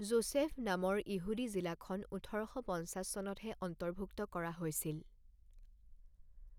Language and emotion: Assamese, neutral